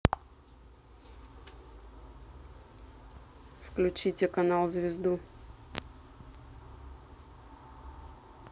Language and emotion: Russian, neutral